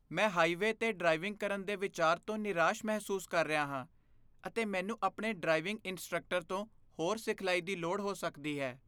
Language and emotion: Punjabi, fearful